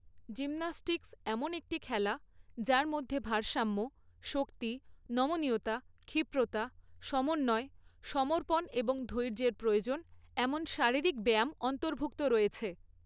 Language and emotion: Bengali, neutral